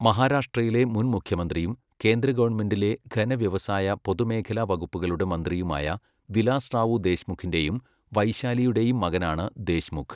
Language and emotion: Malayalam, neutral